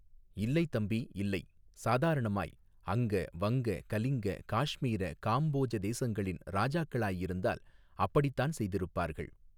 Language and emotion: Tamil, neutral